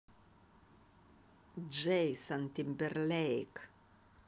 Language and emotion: Russian, positive